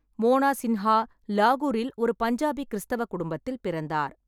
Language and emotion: Tamil, neutral